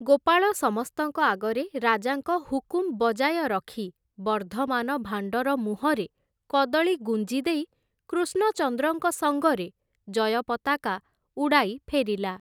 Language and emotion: Odia, neutral